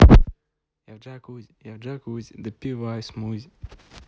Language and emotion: Russian, positive